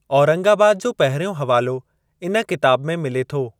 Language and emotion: Sindhi, neutral